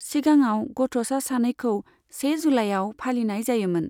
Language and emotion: Bodo, neutral